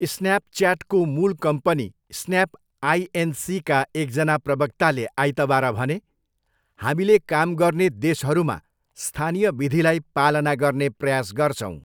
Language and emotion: Nepali, neutral